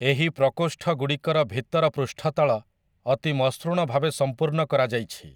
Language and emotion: Odia, neutral